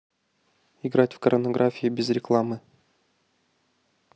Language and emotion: Russian, neutral